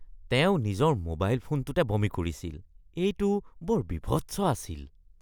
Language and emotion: Assamese, disgusted